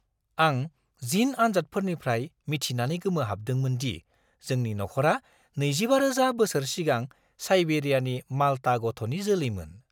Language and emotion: Bodo, surprised